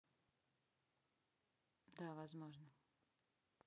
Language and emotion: Russian, neutral